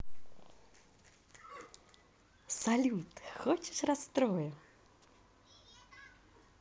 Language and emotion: Russian, neutral